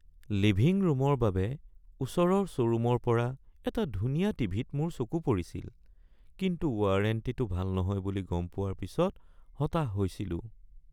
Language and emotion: Assamese, sad